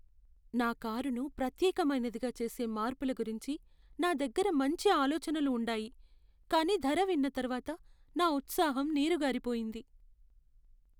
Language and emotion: Telugu, sad